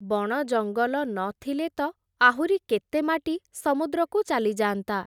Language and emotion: Odia, neutral